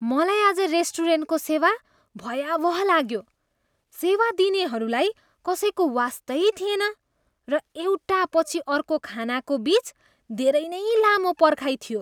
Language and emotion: Nepali, disgusted